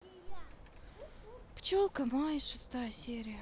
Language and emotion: Russian, sad